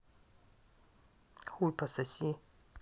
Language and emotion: Russian, angry